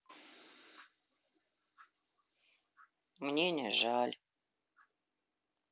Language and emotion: Russian, sad